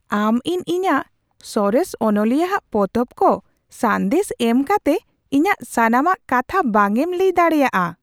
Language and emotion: Santali, surprised